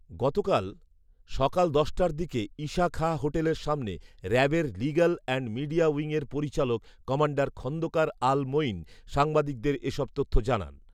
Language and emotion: Bengali, neutral